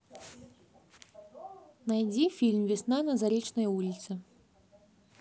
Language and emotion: Russian, neutral